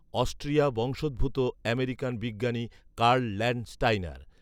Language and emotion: Bengali, neutral